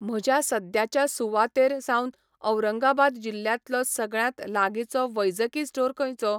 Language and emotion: Goan Konkani, neutral